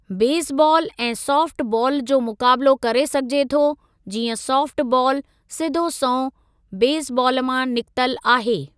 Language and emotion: Sindhi, neutral